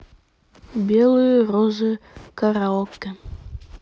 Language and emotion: Russian, neutral